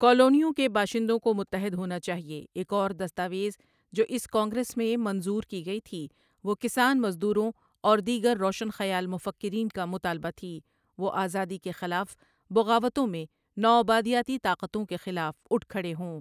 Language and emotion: Urdu, neutral